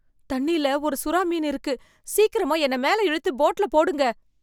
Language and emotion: Tamil, fearful